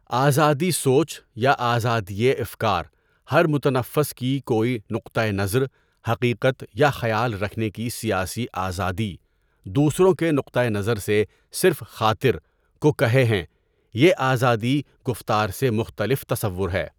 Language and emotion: Urdu, neutral